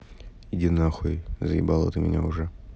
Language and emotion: Russian, neutral